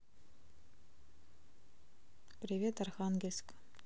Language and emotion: Russian, neutral